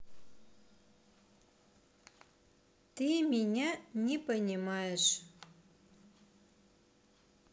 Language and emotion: Russian, neutral